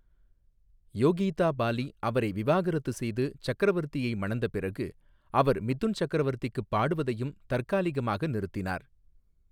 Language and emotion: Tamil, neutral